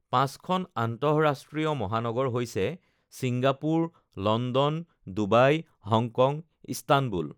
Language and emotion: Assamese, neutral